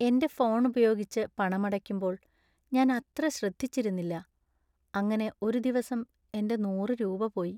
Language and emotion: Malayalam, sad